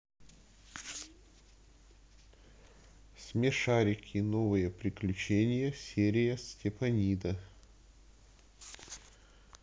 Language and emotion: Russian, neutral